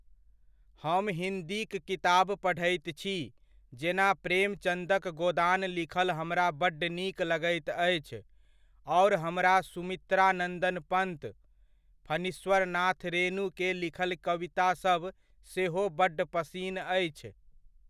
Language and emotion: Maithili, neutral